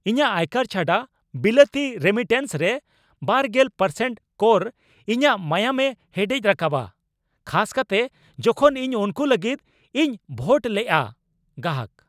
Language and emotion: Santali, angry